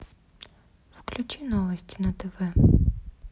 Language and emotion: Russian, neutral